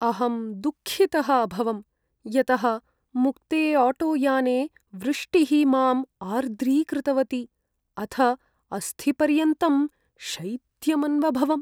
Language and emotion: Sanskrit, sad